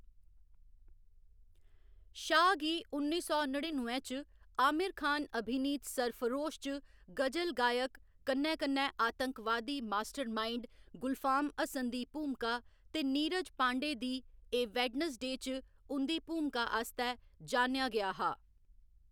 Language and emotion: Dogri, neutral